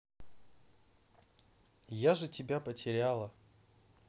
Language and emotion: Russian, neutral